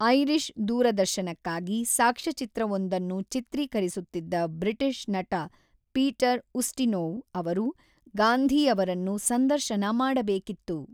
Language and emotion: Kannada, neutral